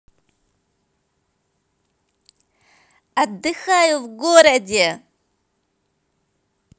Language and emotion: Russian, positive